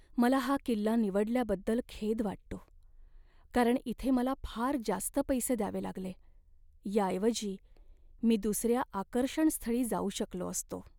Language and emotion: Marathi, sad